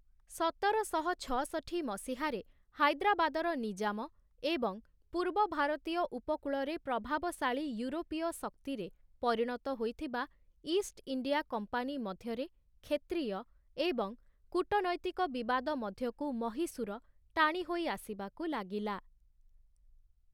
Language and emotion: Odia, neutral